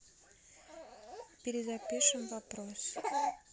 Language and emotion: Russian, neutral